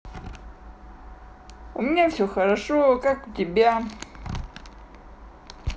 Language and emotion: Russian, positive